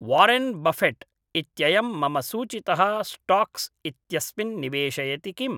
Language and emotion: Sanskrit, neutral